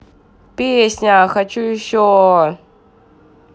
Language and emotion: Russian, neutral